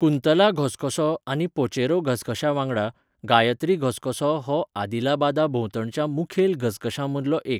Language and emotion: Goan Konkani, neutral